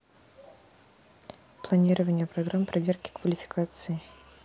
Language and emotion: Russian, neutral